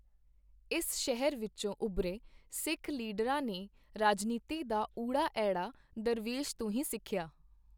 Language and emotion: Punjabi, neutral